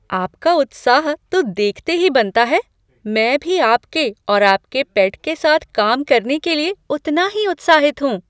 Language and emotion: Hindi, surprised